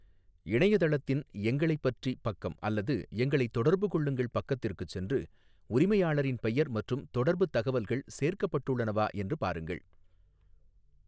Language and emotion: Tamil, neutral